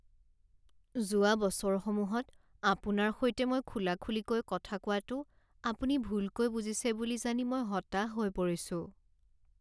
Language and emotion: Assamese, sad